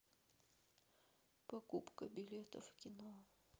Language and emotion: Russian, sad